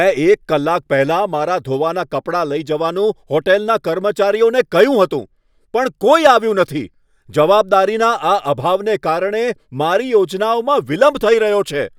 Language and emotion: Gujarati, angry